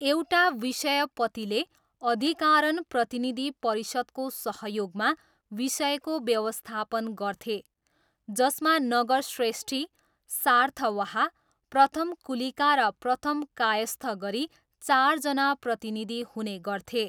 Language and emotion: Nepali, neutral